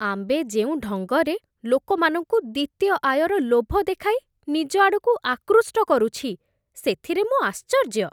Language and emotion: Odia, disgusted